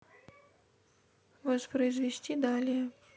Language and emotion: Russian, neutral